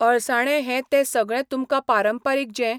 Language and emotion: Goan Konkani, neutral